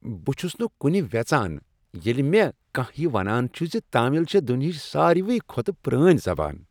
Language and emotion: Kashmiri, happy